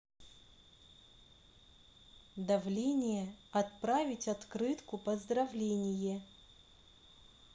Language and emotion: Russian, neutral